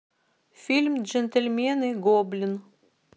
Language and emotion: Russian, neutral